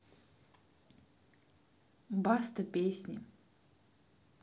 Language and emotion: Russian, neutral